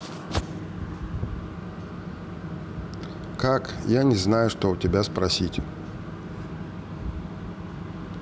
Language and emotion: Russian, neutral